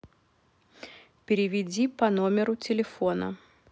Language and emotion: Russian, neutral